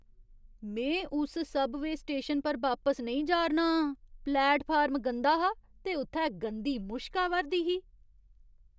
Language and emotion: Dogri, disgusted